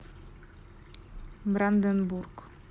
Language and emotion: Russian, neutral